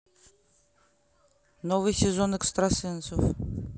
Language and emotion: Russian, neutral